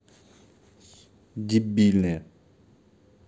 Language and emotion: Russian, angry